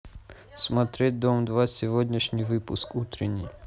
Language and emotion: Russian, neutral